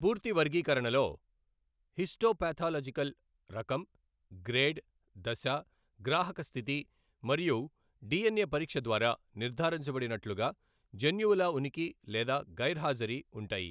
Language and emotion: Telugu, neutral